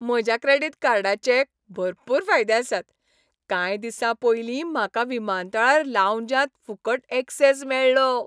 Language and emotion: Goan Konkani, happy